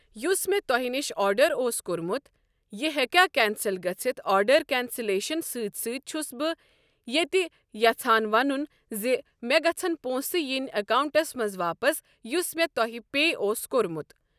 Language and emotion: Kashmiri, neutral